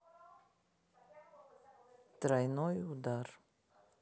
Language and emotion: Russian, neutral